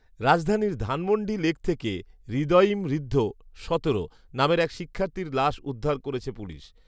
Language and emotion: Bengali, neutral